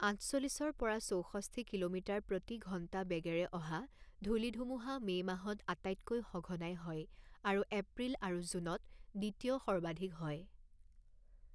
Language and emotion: Assamese, neutral